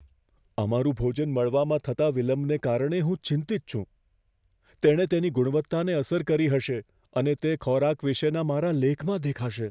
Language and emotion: Gujarati, fearful